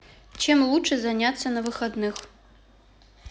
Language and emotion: Russian, neutral